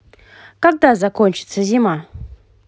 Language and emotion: Russian, positive